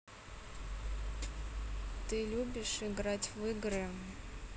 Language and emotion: Russian, neutral